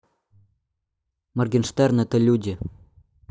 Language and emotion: Russian, neutral